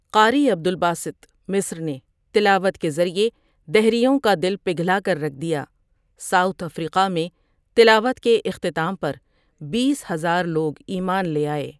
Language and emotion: Urdu, neutral